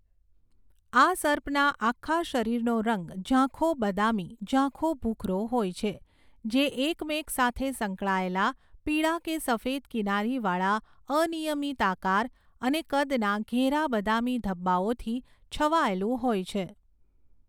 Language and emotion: Gujarati, neutral